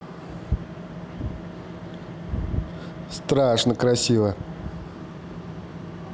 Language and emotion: Russian, positive